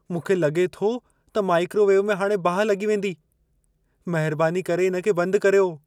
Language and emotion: Sindhi, fearful